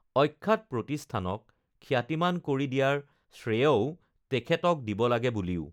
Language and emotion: Assamese, neutral